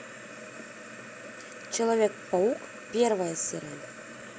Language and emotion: Russian, neutral